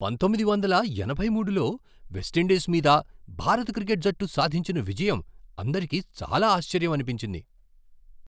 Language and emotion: Telugu, surprised